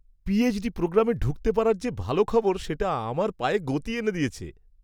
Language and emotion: Bengali, happy